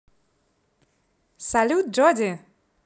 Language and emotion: Russian, positive